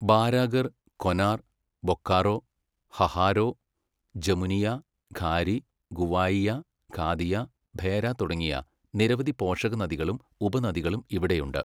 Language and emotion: Malayalam, neutral